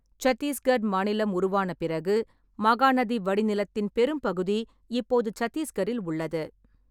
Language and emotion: Tamil, neutral